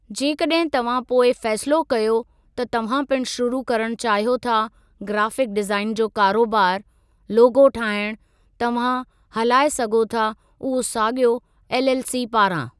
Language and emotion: Sindhi, neutral